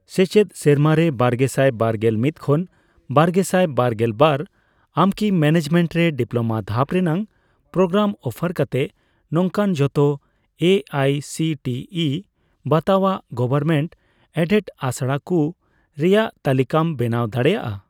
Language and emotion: Santali, neutral